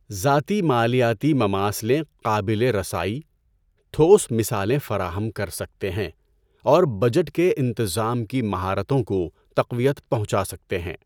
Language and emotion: Urdu, neutral